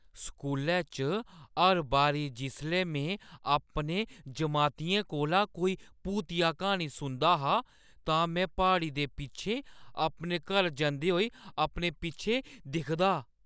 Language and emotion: Dogri, fearful